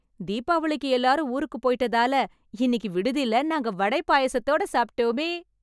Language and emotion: Tamil, happy